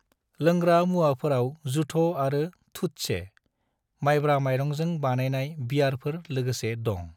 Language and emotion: Bodo, neutral